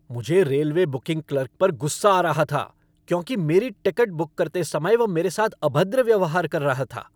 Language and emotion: Hindi, angry